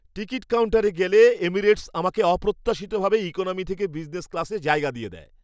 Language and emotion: Bengali, surprised